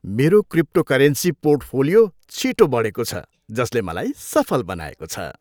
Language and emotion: Nepali, happy